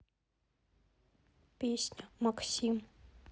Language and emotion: Russian, neutral